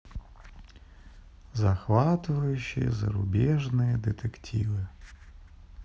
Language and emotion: Russian, sad